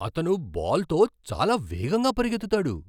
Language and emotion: Telugu, surprised